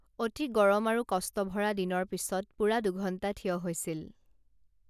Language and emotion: Assamese, neutral